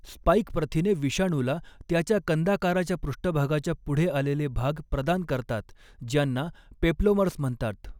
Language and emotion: Marathi, neutral